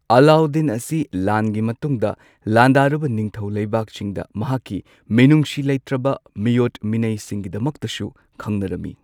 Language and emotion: Manipuri, neutral